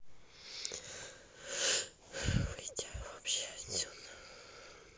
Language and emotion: Russian, sad